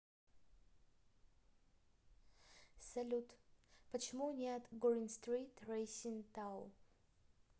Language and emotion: Russian, neutral